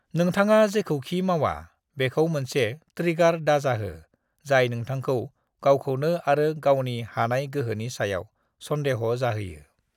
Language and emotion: Bodo, neutral